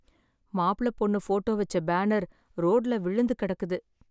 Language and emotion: Tamil, sad